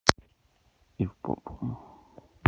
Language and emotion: Russian, neutral